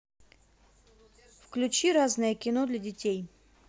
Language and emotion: Russian, neutral